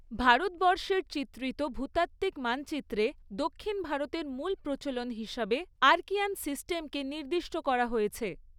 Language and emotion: Bengali, neutral